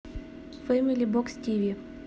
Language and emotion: Russian, neutral